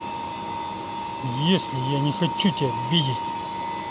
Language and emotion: Russian, angry